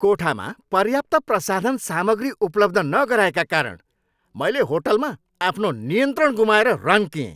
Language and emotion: Nepali, angry